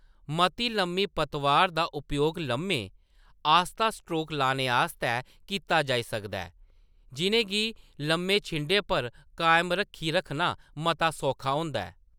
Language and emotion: Dogri, neutral